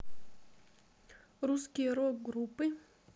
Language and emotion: Russian, neutral